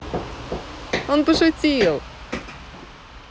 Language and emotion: Russian, positive